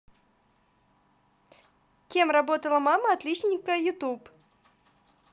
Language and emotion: Russian, positive